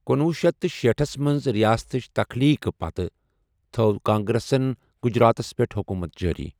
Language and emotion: Kashmiri, neutral